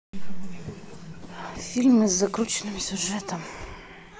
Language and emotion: Russian, sad